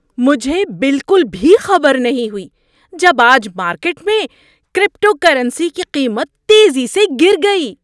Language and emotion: Urdu, surprised